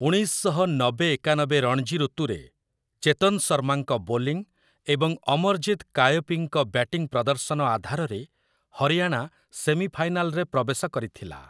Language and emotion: Odia, neutral